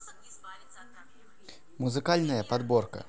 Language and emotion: Russian, neutral